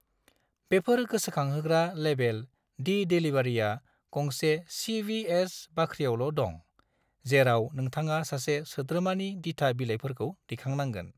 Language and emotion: Bodo, neutral